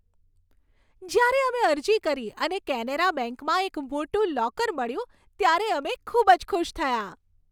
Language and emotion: Gujarati, happy